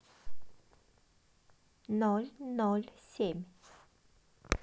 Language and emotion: Russian, positive